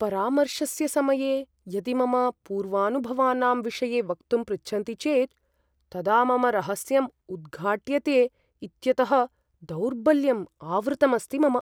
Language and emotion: Sanskrit, fearful